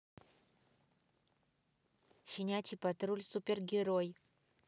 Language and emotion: Russian, neutral